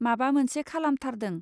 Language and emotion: Bodo, neutral